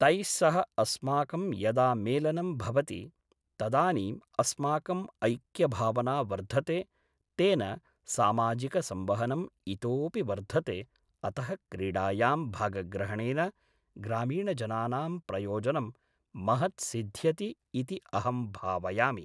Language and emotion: Sanskrit, neutral